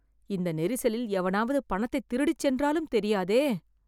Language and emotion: Tamil, fearful